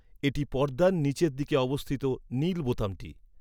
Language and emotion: Bengali, neutral